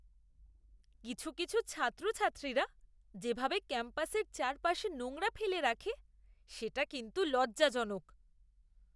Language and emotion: Bengali, disgusted